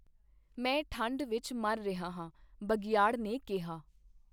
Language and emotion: Punjabi, neutral